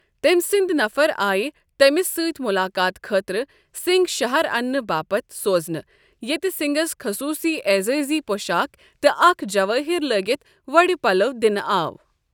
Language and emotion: Kashmiri, neutral